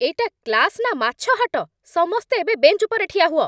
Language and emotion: Odia, angry